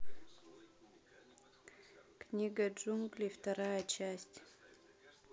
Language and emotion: Russian, neutral